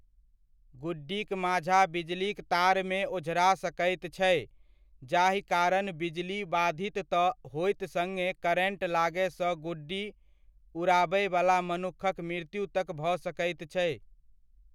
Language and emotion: Maithili, neutral